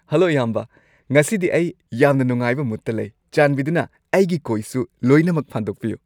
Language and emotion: Manipuri, happy